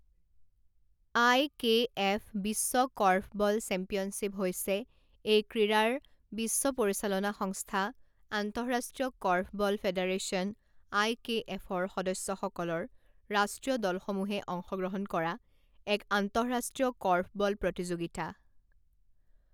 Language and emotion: Assamese, neutral